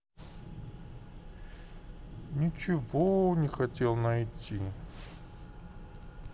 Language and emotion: Russian, sad